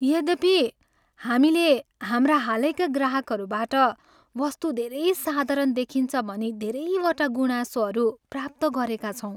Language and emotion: Nepali, sad